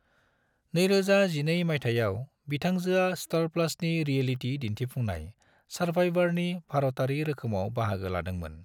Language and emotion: Bodo, neutral